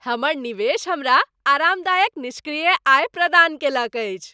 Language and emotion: Maithili, happy